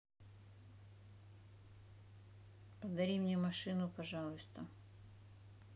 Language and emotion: Russian, neutral